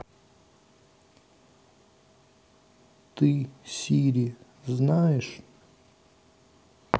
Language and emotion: Russian, sad